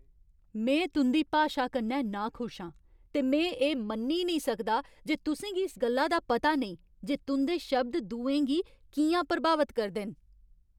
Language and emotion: Dogri, angry